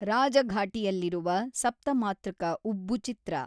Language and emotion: Kannada, neutral